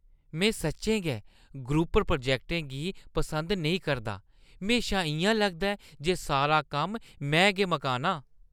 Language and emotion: Dogri, disgusted